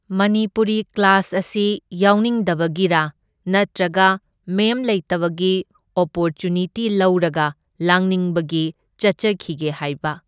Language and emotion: Manipuri, neutral